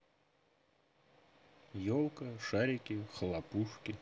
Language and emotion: Russian, neutral